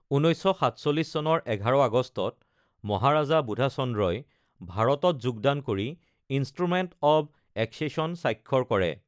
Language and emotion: Assamese, neutral